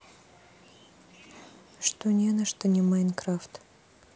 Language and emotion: Russian, sad